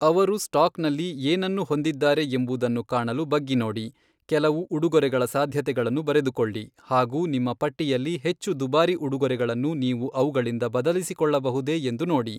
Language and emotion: Kannada, neutral